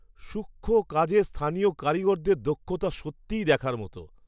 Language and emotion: Bengali, surprised